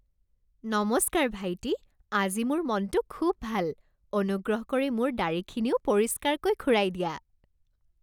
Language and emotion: Assamese, happy